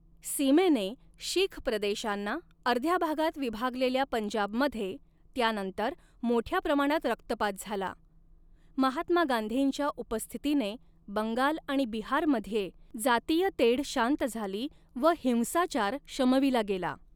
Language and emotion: Marathi, neutral